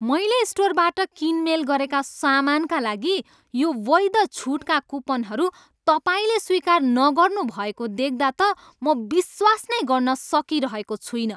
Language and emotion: Nepali, angry